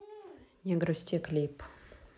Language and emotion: Russian, neutral